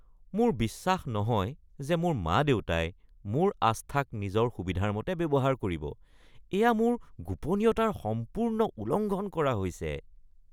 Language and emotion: Assamese, disgusted